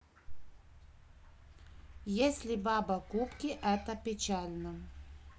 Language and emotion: Russian, neutral